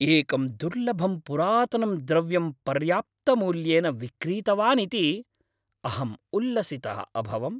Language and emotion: Sanskrit, happy